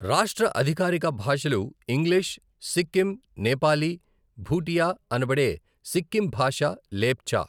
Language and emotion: Telugu, neutral